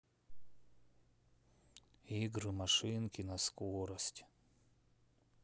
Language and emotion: Russian, sad